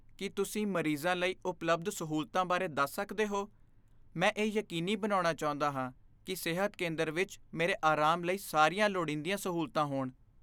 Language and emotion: Punjabi, fearful